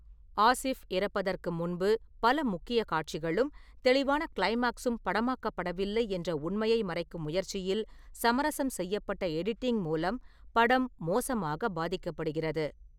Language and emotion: Tamil, neutral